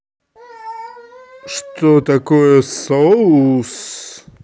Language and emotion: Russian, neutral